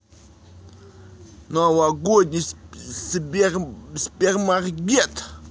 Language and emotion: Russian, neutral